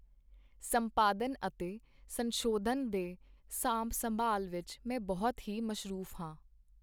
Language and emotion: Punjabi, neutral